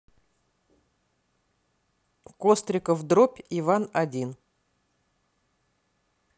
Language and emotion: Russian, neutral